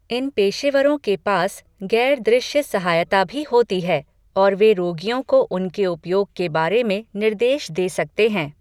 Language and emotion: Hindi, neutral